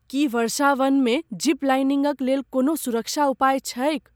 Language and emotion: Maithili, fearful